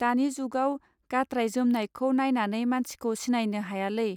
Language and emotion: Bodo, neutral